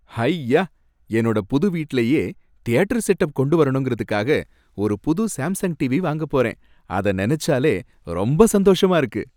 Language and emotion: Tamil, happy